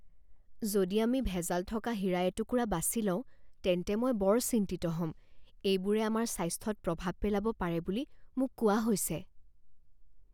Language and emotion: Assamese, fearful